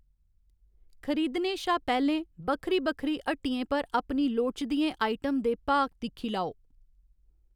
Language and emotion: Dogri, neutral